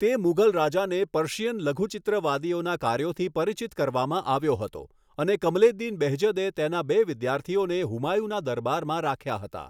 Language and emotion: Gujarati, neutral